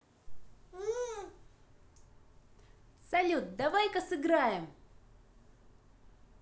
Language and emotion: Russian, positive